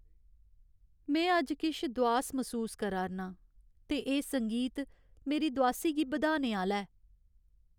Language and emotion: Dogri, sad